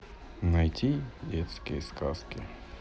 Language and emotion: Russian, neutral